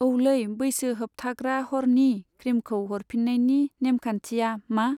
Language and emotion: Bodo, neutral